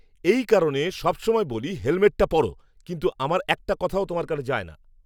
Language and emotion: Bengali, angry